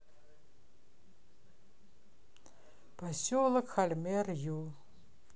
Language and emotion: Russian, neutral